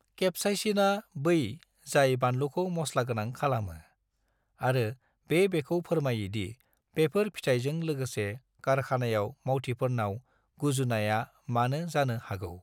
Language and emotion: Bodo, neutral